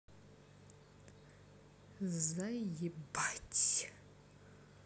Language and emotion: Russian, neutral